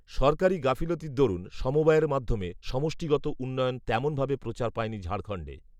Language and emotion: Bengali, neutral